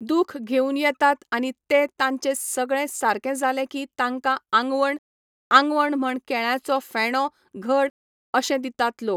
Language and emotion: Goan Konkani, neutral